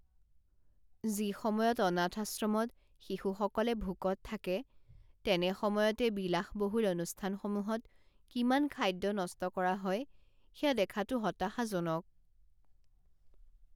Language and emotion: Assamese, sad